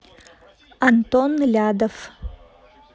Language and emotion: Russian, neutral